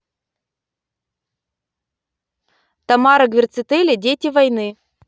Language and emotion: Russian, neutral